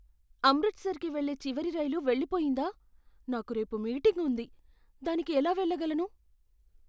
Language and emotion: Telugu, fearful